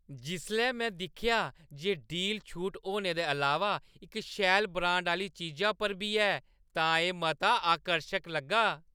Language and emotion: Dogri, happy